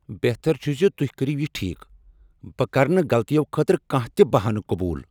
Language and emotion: Kashmiri, angry